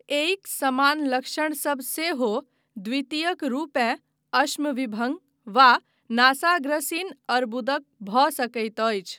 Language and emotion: Maithili, neutral